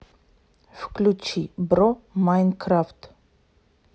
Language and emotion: Russian, neutral